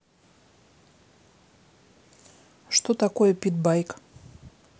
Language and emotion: Russian, neutral